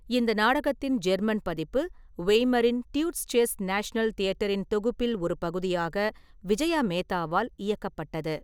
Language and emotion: Tamil, neutral